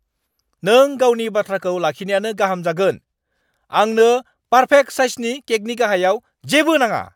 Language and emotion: Bodo, angry